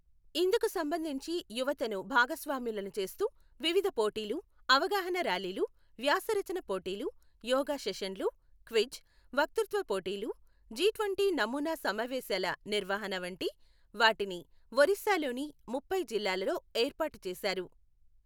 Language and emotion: Telugu, neutral